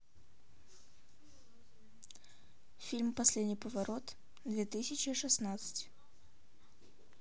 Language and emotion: Russian, neutral